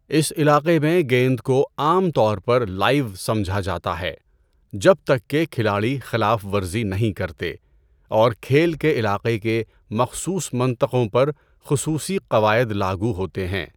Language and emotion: Urdu, neutral